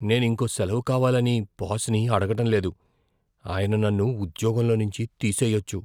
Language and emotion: Telugu, fearful